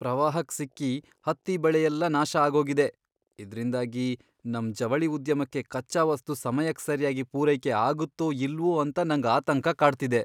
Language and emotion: Kannada, fearful